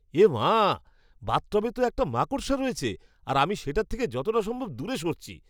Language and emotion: Bengali, disgusted